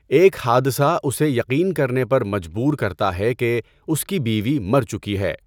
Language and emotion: Urdu, neutral